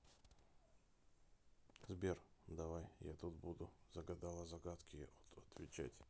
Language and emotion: Russian, neutral